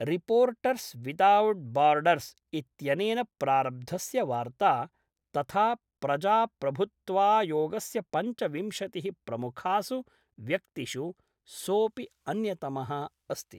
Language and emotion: Sanskrit, neutral